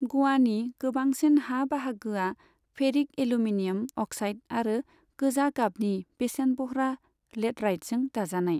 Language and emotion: Bodo, neutral